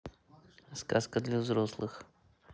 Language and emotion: Russian, neutral